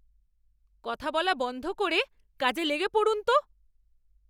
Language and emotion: Bengali, angry